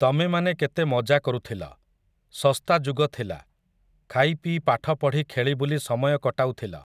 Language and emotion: Odia, neutral